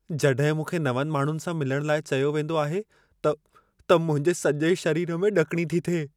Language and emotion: Sindhi, fearful